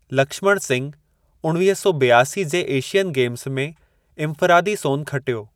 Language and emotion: Sindhi, neutral